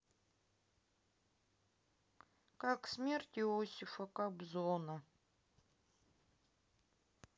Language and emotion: Russian, sad